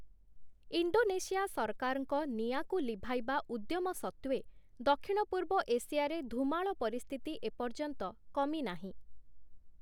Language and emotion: Odia, neutral